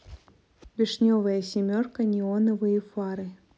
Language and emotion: Russian, neutral